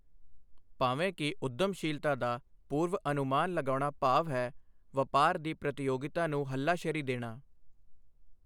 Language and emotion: Punjabi, neutral